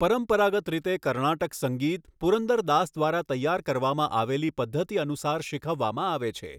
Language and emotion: Gujarati, neutral